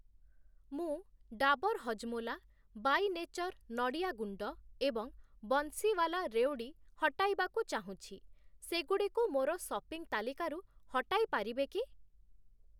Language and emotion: Odia, neutral